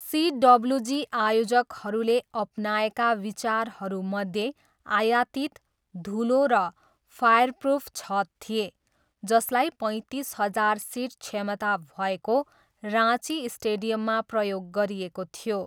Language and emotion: Nepali, neutral